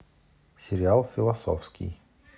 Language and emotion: Russian, neutral